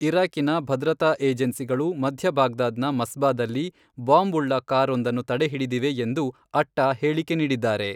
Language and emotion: Kannada, neutral